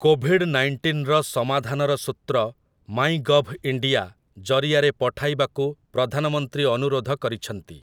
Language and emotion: Odia, neutral